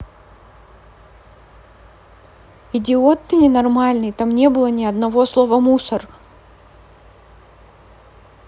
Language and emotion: Russian, angry